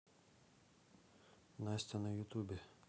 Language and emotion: Russian, neutral